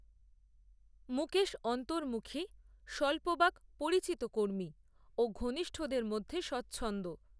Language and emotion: Bengali, neutral